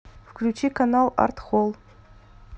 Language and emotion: Russian, neutral